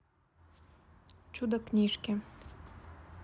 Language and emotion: Russian, neutral